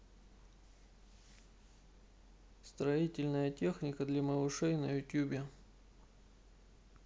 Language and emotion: Russian, neutral